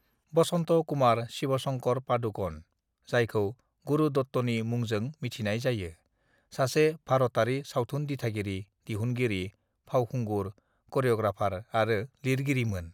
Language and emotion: Bodo, neutral